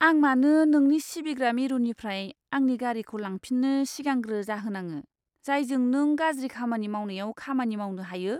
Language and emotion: Bodo, disgusted